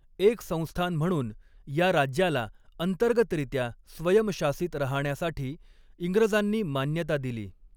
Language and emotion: Marathi, neutral